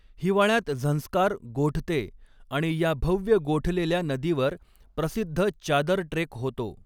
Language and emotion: Marathi, neutral